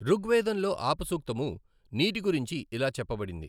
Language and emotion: Telugu, neutral